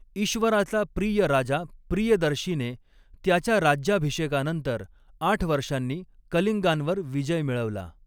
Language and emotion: Marathi, neutral